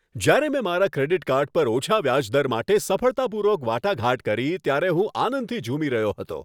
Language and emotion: Gujarati, happy